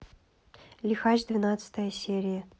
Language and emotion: Russian, neutral